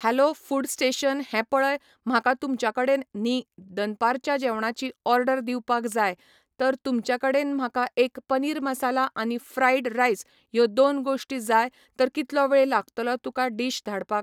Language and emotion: Goan Konkani, neutral